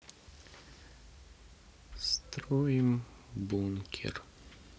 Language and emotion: Russian, sad